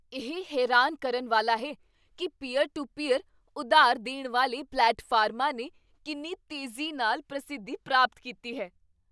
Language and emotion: Punjabi, surprised